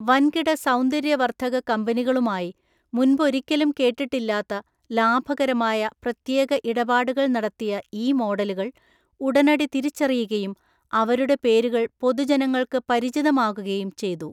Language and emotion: Malayalam, neutral